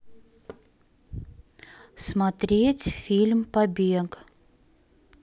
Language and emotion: Russian, neutral